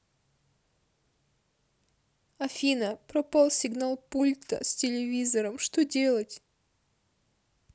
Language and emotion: Russian, sad